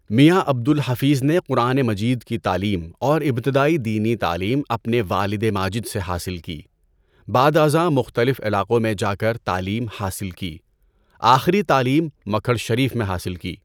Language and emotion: Urdu, neutral